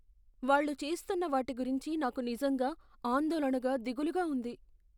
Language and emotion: Telugu, fearful